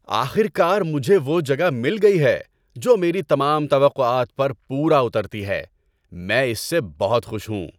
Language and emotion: Urdu, happy